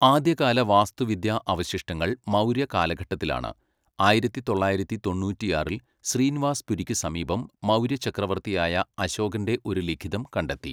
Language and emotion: Malayalam, neutral